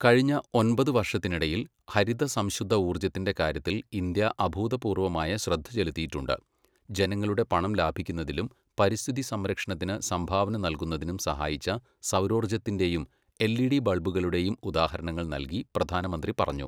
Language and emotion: Malayalam, neutral